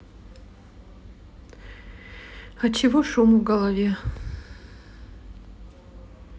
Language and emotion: Russian, sad